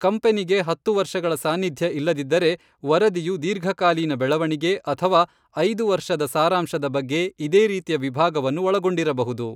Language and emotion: Kannada, neutral